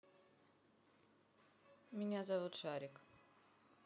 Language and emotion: Russian, neutral